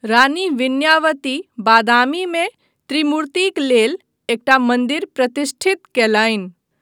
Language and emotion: Maithili, neutral